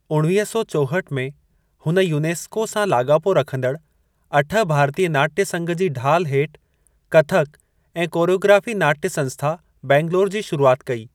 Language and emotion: Sindhi, neutral